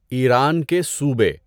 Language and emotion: Urdu, neutral